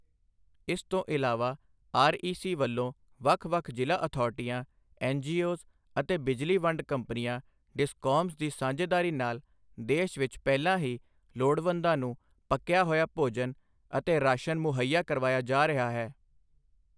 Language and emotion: Punjabi, neutral